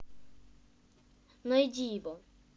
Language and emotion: Russian, neutral